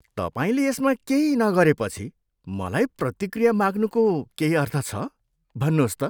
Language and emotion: Nepali, disgusted